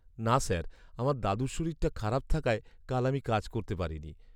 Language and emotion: Bengali, sad